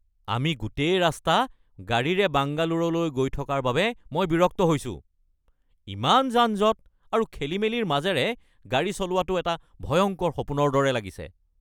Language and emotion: Assamese, angry